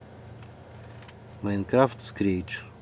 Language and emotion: Russian, neutral